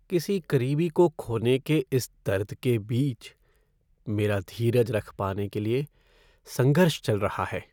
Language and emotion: Hindi, sad